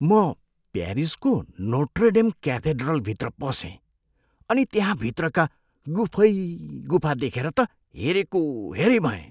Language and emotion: Nepali, surprised